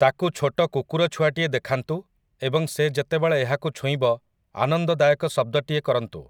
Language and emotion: Odia, neutral